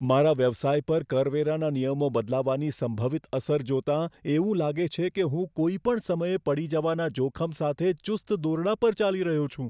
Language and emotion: Gujarati, fearful